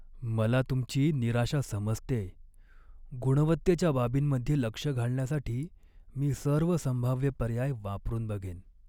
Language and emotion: Marathi, sad